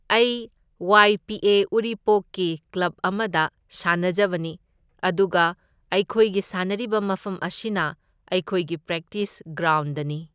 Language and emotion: Manipuri, neutral